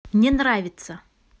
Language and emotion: Russian, neutral